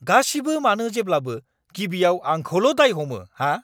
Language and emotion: Bodo, angry